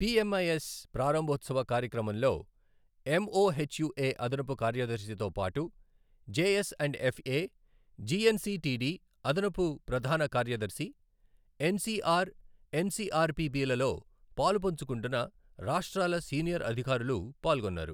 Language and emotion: Telugu, neutral